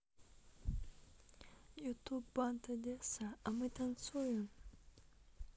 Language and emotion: Russian, neutral